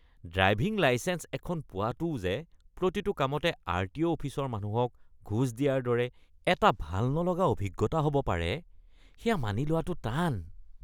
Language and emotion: Assamese, disgusted